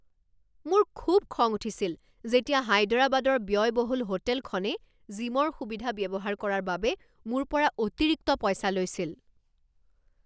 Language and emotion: Assamese, angry